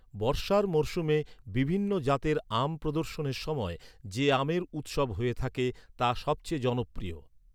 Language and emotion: Bengali, neutral